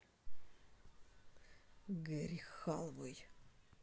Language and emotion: Russian, neutral